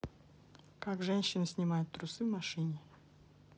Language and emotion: Russian, neutral